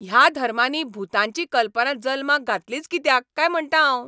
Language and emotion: Goan Konkani, angry